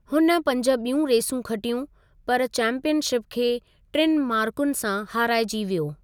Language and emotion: Sindhi, neutral